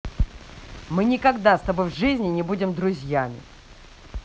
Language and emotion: Russian, angry